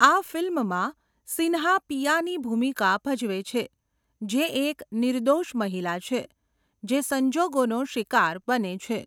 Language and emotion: Gujarati, neutral